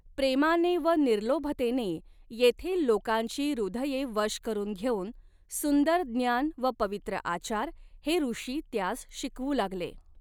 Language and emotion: Marathi, neutral